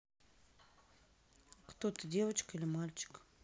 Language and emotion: Russian, neutral